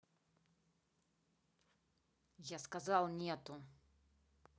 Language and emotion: Russian, angry